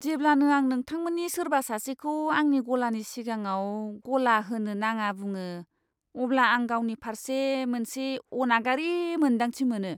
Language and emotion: Bodo, disgusted